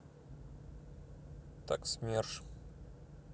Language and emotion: Russian, neutral